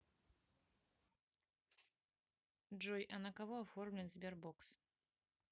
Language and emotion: Russian, neutral